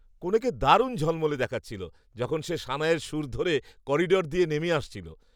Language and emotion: Bengali, happy